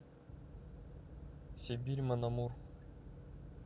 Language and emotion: Russian, neutral